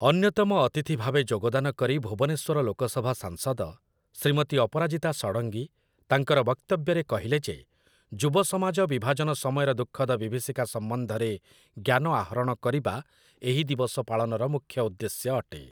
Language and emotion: Odia, neutral